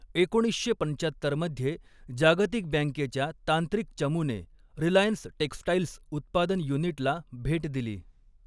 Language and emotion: Marathi, neutral